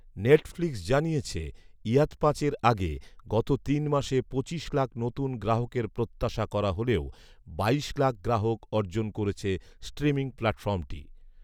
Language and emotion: Bengali, neutral